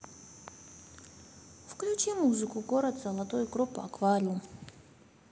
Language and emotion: Russian, neutral